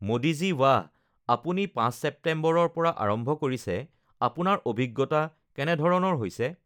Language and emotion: Assamese, neutral